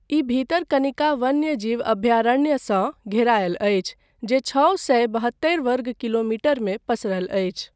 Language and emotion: Maithili, neutral